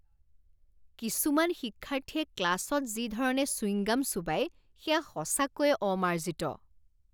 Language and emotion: Assamese, disgusted